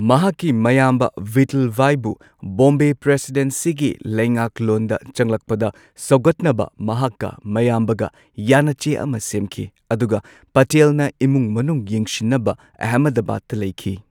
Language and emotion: Manipuri, neutral